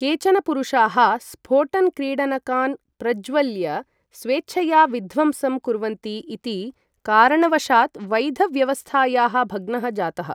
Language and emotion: Sanskrit, neutral